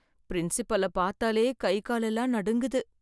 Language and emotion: Tamil, fearful